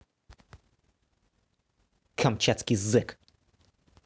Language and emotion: Russian, angry